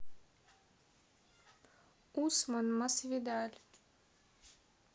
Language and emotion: Russian, neutral